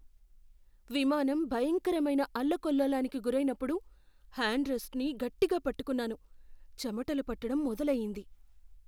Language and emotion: Telugu, fearful